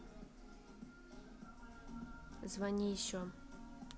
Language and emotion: Russian, neutral